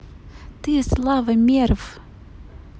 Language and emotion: Russian, neutral